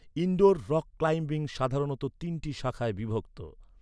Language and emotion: Bengali, neutral